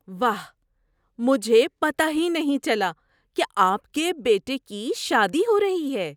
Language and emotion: Urdu, surprised